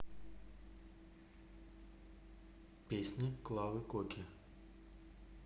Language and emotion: Russian, neutral